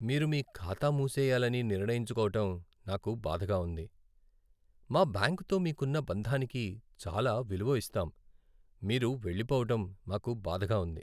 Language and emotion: Telugu, sad